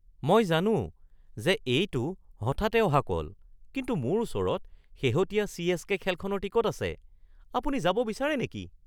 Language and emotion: Assamese, surprised